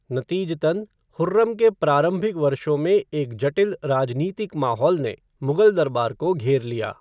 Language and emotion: Hindi, neutral